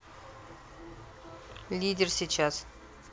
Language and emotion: Russian, neutral